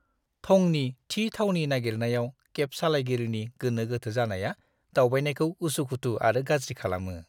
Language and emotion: Bodo, disgusted